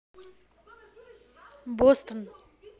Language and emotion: Russian, neutral